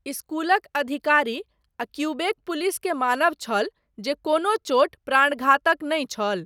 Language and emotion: Maithili, neutral